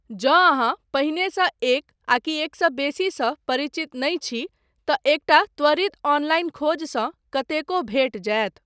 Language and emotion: Maithili, neutral